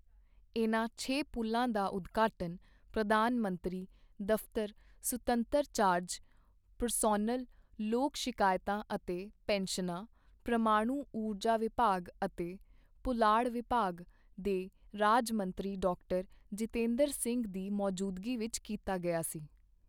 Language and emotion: Punjabi, neutral